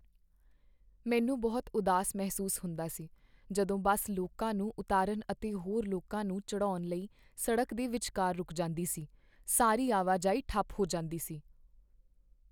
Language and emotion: Punjabi, sad